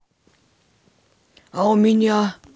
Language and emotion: Russian, neutral